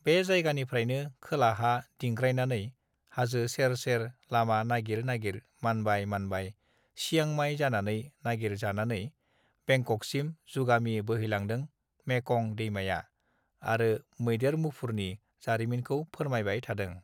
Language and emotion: Bodo, neutral